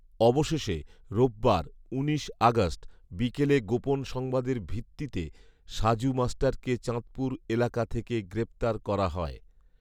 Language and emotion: Bengali, neutral